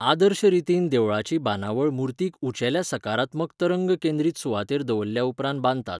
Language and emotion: Goan Konkani, neutral